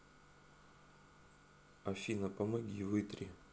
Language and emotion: Russian, neutral